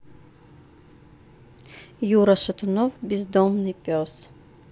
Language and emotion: Russian, neutral